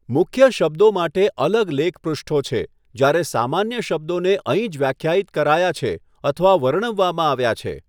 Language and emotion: Gujarati, neutral